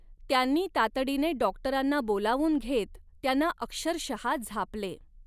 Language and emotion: Marathi, neutral